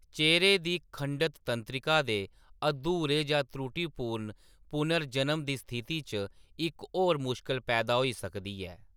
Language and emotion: Dogri, neutral